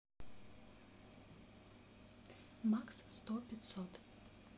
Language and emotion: Russian, neutral